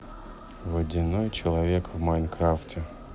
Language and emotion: Russian, neutral